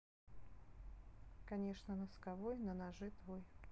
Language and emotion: Russian, neutral